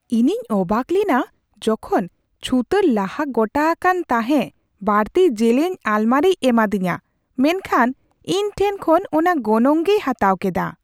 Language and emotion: Santali, surprised